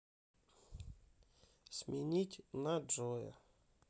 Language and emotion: Russian, neutral